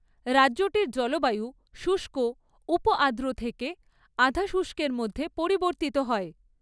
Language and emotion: Bengali, neutral